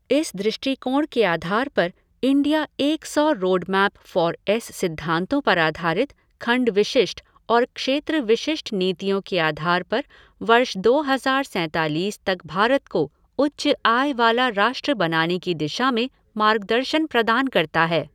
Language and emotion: Hindi, neutral